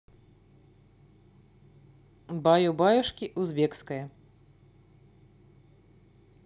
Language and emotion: Russian, neutral